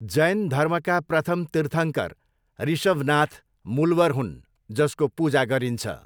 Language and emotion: Nepali, neutral